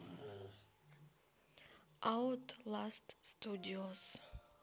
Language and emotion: Russian, neutral